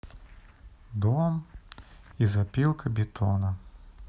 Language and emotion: Russian, neutral